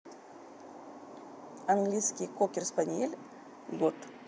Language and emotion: Russian, neutral